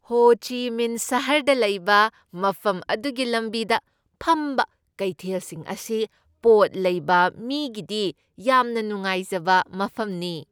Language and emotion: Manipuri, happy